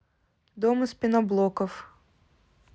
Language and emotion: Russian, neutral